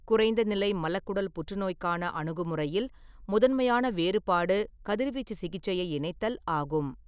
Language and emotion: Tamil, neutral